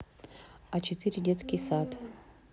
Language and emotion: Russian, neutral